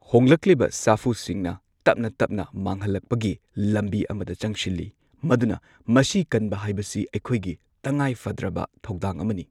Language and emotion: Manipuri, neutral